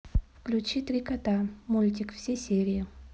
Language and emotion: Russian, neutral